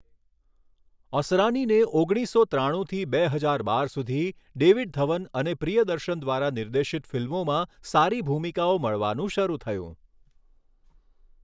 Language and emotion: Gujarati, neutral